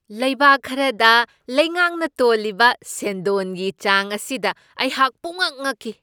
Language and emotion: Manipuri, surprised